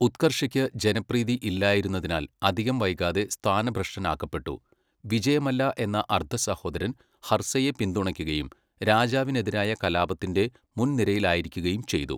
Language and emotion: Malayalam, neutral